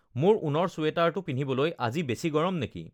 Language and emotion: Assamese, neutral